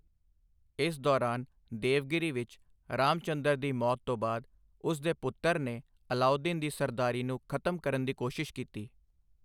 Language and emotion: Punjabi, neutral